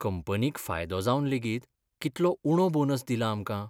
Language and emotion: Goan Konkani, sad